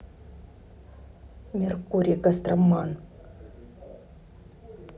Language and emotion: Russian, angry